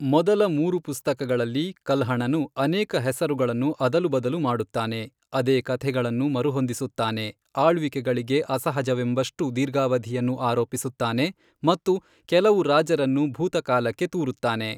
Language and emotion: Kannada, neutral